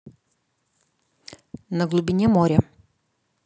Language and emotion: Russian, neutral